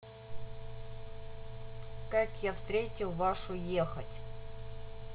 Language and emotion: Russian, neutral